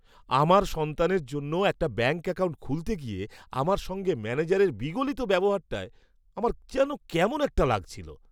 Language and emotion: Bengali, disgusted